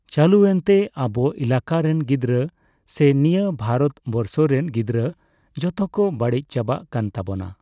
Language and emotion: Santali, neutral